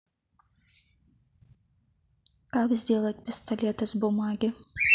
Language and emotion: Russian, neutral